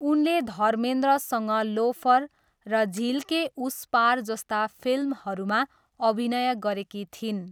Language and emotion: Nepali, neutral